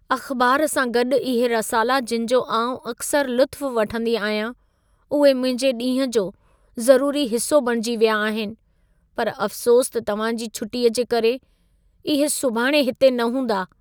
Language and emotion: Sindhi, sad